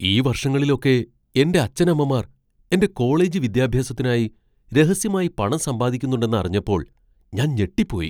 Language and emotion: Malayalam, surprised